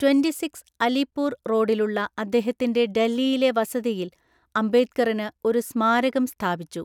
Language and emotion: Malayalam, neutral